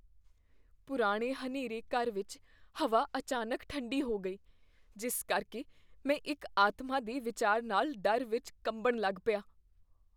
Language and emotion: Punjabi, fearful